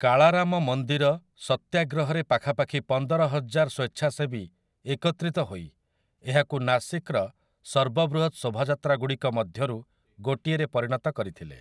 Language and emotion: Odia, neutral